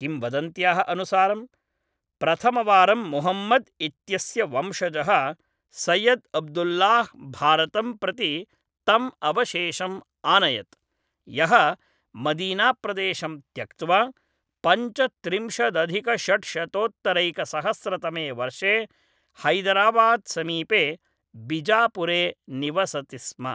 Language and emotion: Sanskrit, neutral